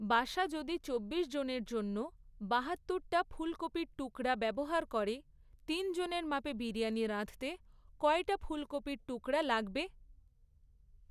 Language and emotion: Bengali, neutral